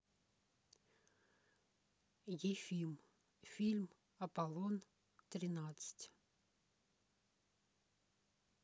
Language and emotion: Russian, neutral